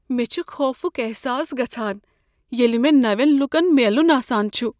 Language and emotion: Kashmiri, fearful